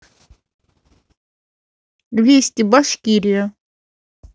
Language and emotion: Russian, neutral